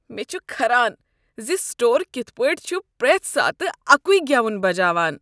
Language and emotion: Kashmiri, disgusted